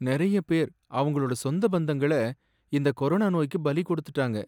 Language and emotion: Tamil, sad